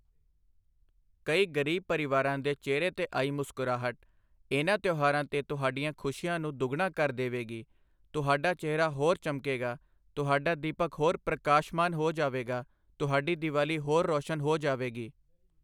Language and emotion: Punjabi, neutral